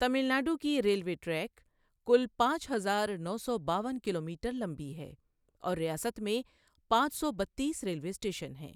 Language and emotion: Urdu, neutral